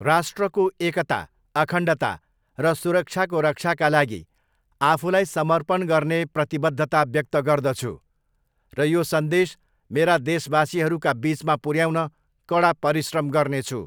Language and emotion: Nepali, neutral